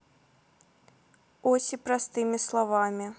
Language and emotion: Russian, neutral